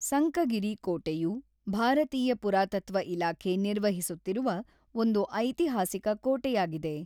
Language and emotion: Kannada, neutral